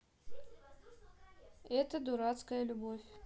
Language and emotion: Russian, neutral